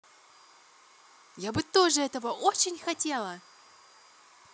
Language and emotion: Russian, positive